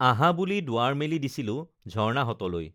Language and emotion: Assamese, neutral